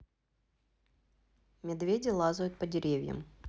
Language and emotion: Russian, neutral